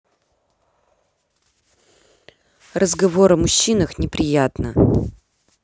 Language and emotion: Russian, angry